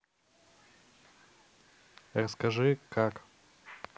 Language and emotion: Russian, neutral